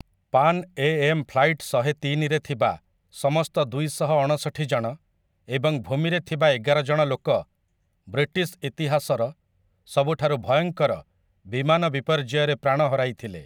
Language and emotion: Odia, neutral